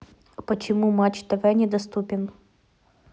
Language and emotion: Russian, neutral